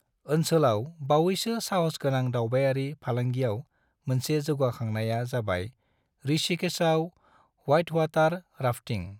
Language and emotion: Bodo, neutral